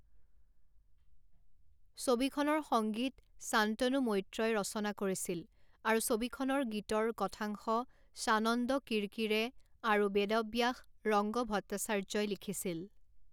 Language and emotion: Assamese, neutral